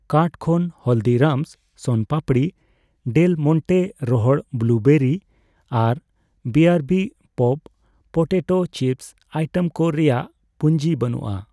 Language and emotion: Santali, neutral